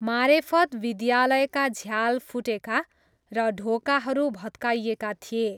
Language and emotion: Nepali, neutral